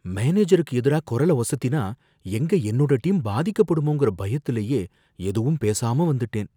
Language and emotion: Tamil, fearful